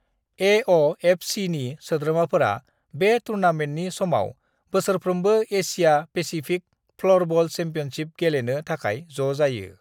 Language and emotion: Bodo, neutral